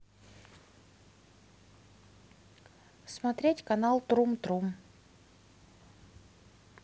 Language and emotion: Russian, neutral